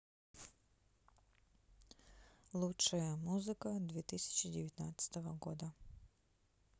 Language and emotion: Russian, neutral